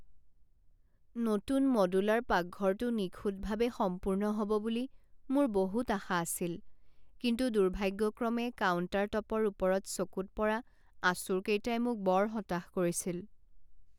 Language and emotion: Assamese, sad